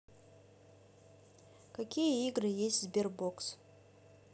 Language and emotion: Russian, neutral